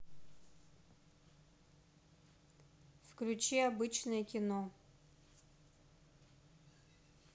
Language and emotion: Russian, neutral